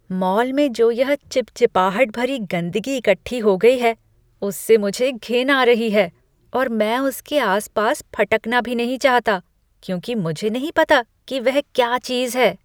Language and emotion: Hindi, disgusted